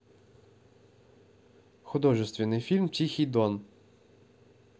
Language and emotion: Russian, neutral